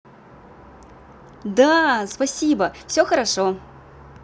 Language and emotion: Russian, positive